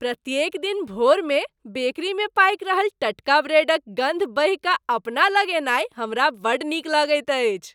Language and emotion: Maithili, happy